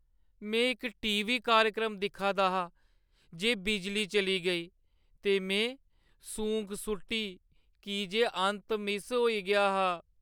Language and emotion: Dogri, sad